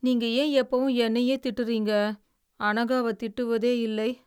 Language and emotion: Tamil, sad